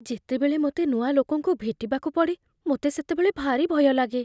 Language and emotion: Odia, fearful